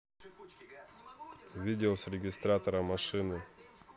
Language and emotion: Russian, neutral